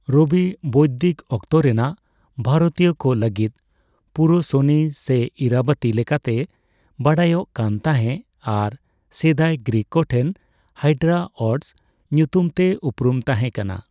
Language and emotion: Santali, neutral